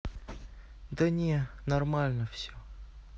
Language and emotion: Russian, neutral